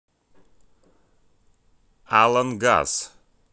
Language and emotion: Russian, neutral